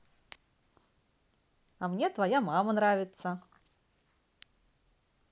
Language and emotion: Russian, positive